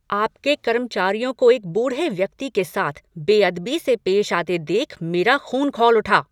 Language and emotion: Hindi, angry